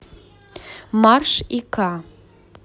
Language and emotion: Russian, neutral